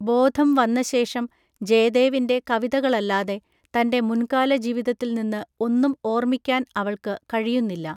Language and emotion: Malayalam, neutral